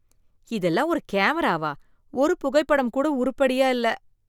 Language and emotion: Tamil, disgusted